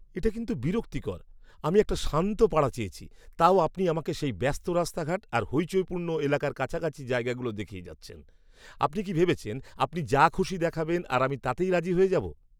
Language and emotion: Bengali, angry